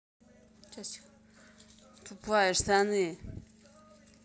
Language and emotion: Russian, angry